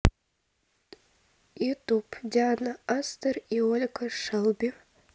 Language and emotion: Russian, neutral